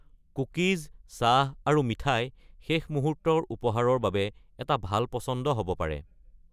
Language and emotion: Assamese, neutral